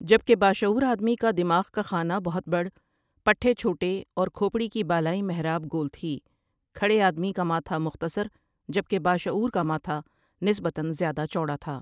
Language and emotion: Urdu, neutral